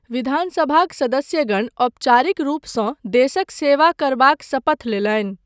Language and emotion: Maithili, neutral